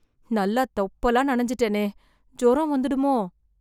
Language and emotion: Tamil, fearful